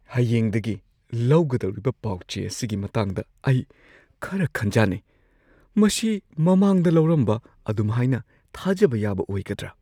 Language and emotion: Manipuri, fearful